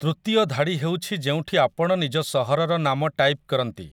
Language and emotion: Odia, neutral